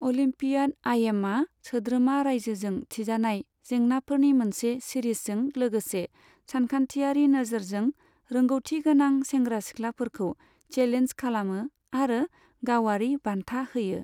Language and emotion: Bodo, neutral